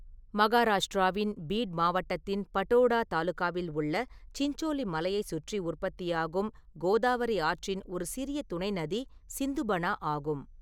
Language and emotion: Tamil, neutral